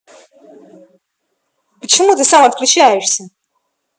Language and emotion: Russian, angry